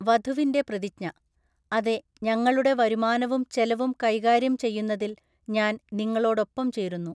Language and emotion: Malayalam, neutral